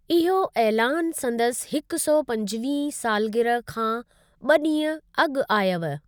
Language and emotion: Sindhi, neutral